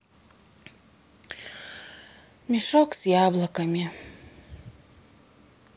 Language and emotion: Russian, sad